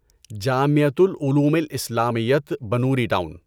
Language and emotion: Urdu, neutral